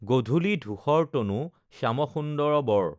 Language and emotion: Assamese, neutral